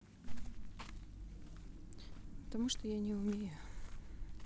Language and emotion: Russian, sad